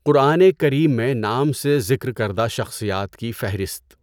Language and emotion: Urdu, neutral